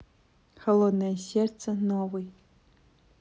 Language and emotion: Russian, neutral